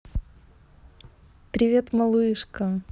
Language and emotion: Russian, positive